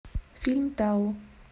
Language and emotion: Russian, neutral